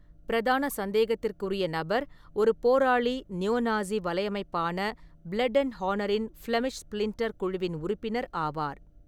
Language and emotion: Tamil, neutral